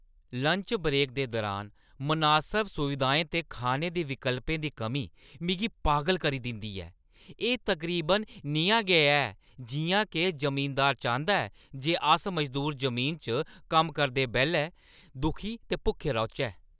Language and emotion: Dogri, angry